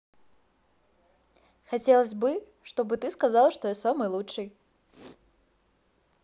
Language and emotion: Russian, positive